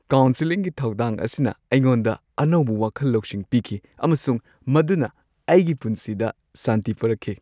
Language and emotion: Manipuri, happy